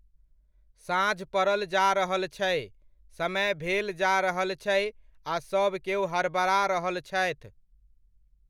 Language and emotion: Maithili, neutral